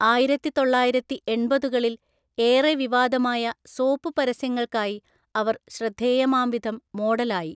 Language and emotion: Malayalam, neutral